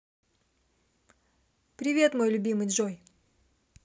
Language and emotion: Russian, positive